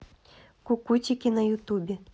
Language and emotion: Russian, neutral